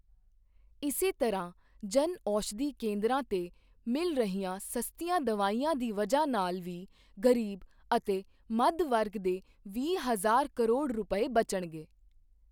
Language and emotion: Punjabi, neutral